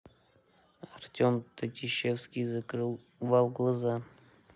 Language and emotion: Russian, neutral